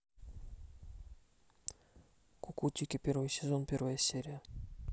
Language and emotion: Russian, neutral